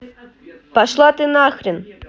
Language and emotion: Russian, angry